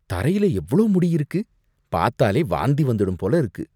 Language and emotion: Tamil, disgusted